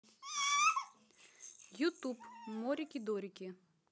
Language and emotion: Russian, neutral